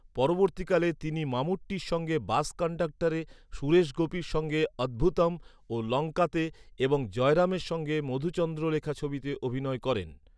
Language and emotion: Bengali, neutral